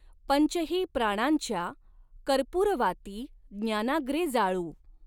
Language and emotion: Marathi, neutral